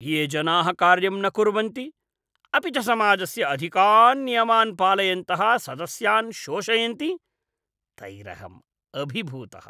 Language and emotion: Sanskrit, disgusted